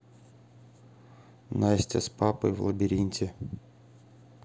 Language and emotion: Russian, neutral